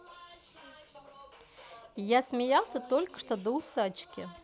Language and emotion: Russian, positive